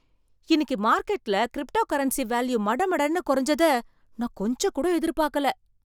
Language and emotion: Tamil, surprised